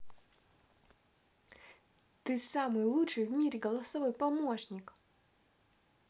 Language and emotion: Russian, positive